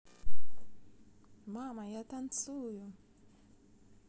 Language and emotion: Russian, positive